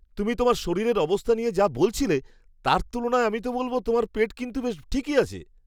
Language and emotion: Bengali, surprised